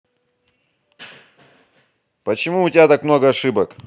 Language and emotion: Russian, angry